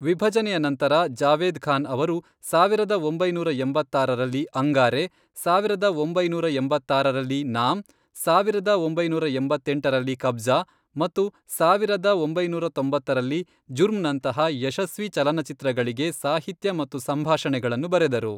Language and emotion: Kannada, neutral